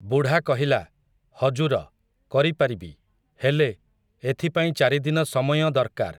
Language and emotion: Odia, neutral